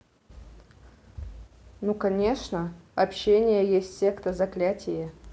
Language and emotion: Russian, neutral